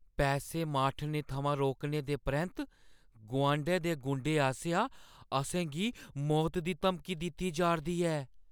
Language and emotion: Dogri, fearful